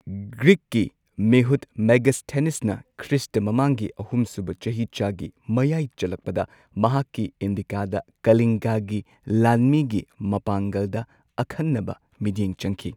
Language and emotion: Manipuri, neutral